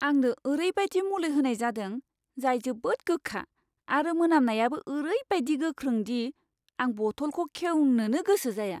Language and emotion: Bodo, disgusted